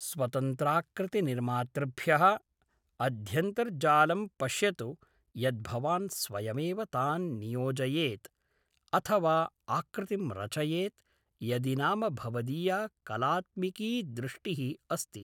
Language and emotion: Sanskrit, neutral